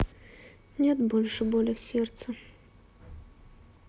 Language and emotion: Russian, sad